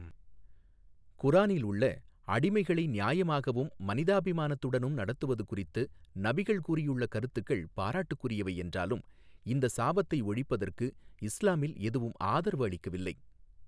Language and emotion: Tamil, neutral